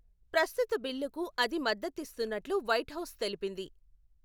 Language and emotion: Telugu, neutral